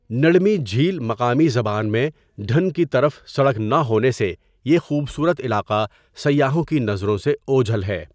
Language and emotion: Urdu, neutral